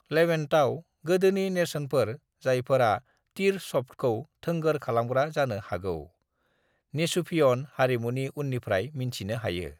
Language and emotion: Bodo, neutral